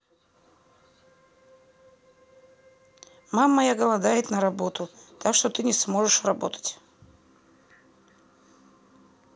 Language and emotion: Russian, neutral